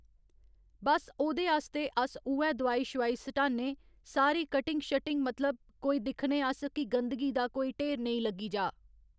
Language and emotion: Dogri, neutral